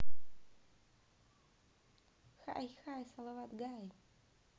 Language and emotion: Russian, positive